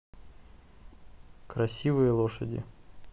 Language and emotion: Russian, neutral